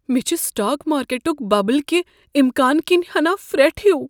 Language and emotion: Kashmiri, fearful